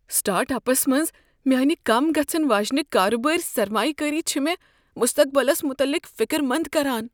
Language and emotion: Kashmiri, fearful